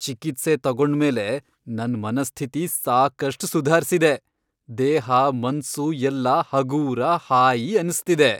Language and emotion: Kannada, happy